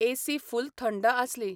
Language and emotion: Goan Konkani, neutral